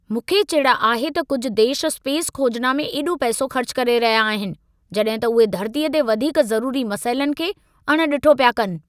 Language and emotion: Sindhi, angry